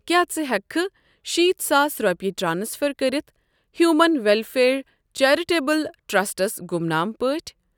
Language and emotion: Kashmiri, neutral